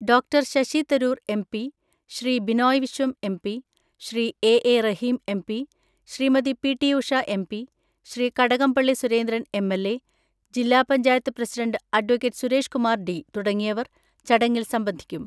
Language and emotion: Malayalam, neutral